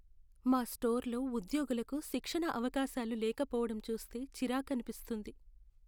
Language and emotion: Telugu, sad